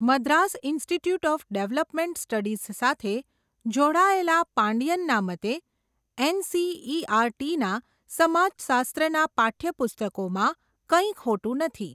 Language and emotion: Gujarati, neutral